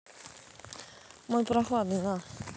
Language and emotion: Russian, neutral